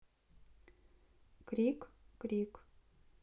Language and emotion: Russian, neutral